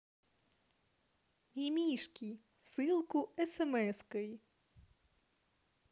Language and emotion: Russian, positive